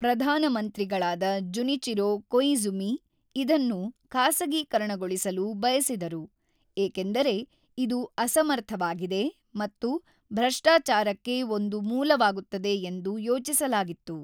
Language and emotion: Kannada, neutral